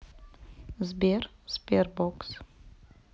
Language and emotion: Russian, neutral